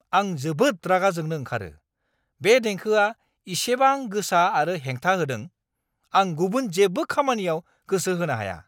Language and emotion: Bodo, angry